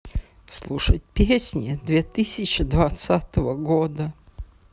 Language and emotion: Russian, sad